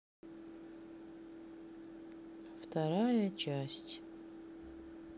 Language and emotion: Russian, sad